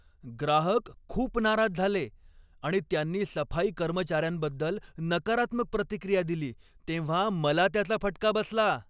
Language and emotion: Marathi, angry